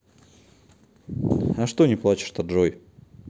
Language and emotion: Russian, neutral